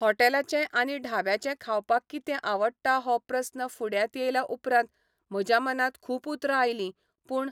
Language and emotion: Goan Konkani, neutral